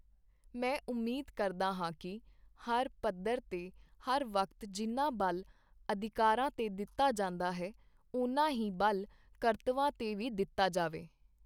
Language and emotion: Punjabi, neutral